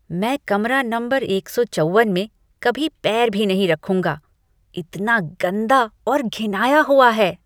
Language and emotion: Hindi, disgusted